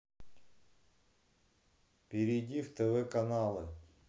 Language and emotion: Russian, neutral